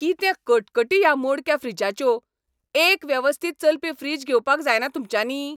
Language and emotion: Goan Konkani, angry